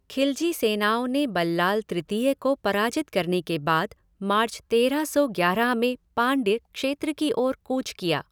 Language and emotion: Hindi, neutral